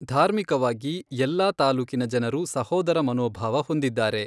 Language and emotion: Kannada, neutral